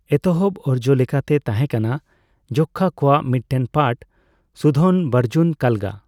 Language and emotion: Santali, neutral